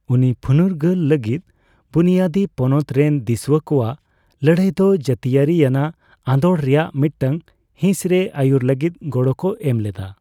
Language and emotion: Santali, neutral